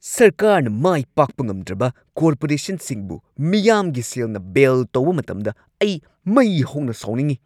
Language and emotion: Manipuri, angry